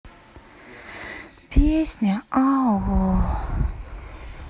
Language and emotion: Russian, sad